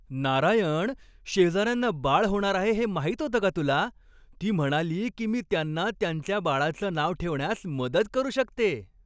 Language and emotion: Marathi, happy